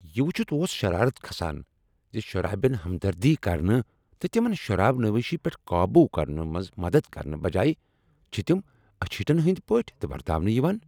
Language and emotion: Kashmiri, angry